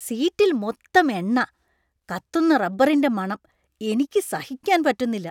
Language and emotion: Malayalam, disgusted